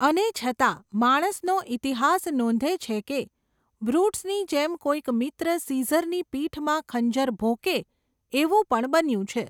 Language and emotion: Gujarati, neutral